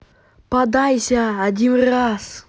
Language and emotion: Russian, angry